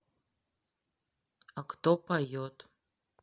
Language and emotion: Russian, neutral